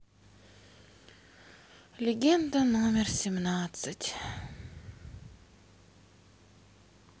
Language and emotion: Russian, sad